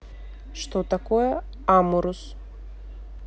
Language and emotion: Russian, neutral